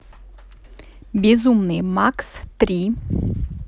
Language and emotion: Russian, neutral